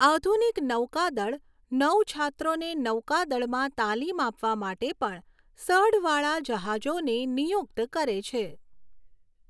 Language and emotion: Gujarati, neutral